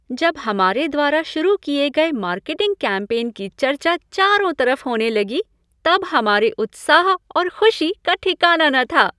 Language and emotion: Hindi, happy